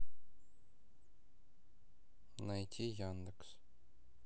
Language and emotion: Russian, neutral